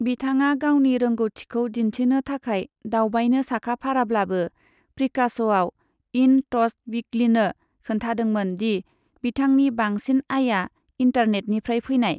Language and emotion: Bodo, neutral